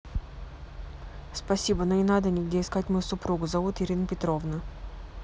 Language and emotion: Russian, neutral